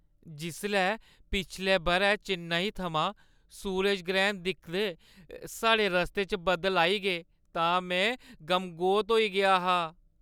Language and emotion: Dogri, sad